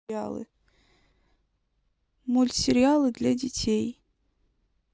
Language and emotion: Russian, sad